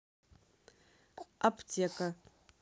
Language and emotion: Russian, neutral